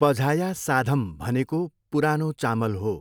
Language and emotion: Nepali, neutral